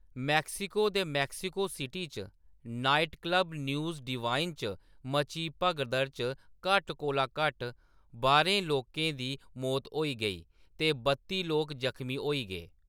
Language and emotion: Dogri, neutral